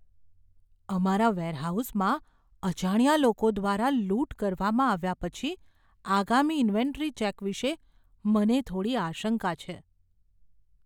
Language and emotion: Gujarati, fearful